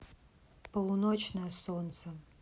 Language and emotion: Russian, sad